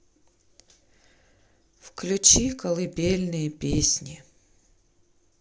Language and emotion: Russian, sad